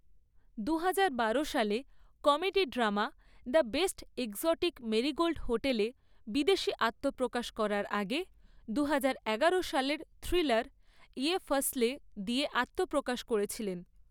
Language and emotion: Bengali, neutral